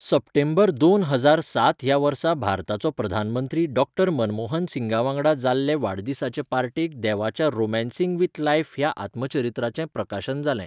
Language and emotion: Goan Konkani, neutral